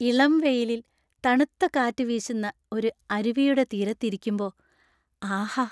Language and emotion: Malayalam, happy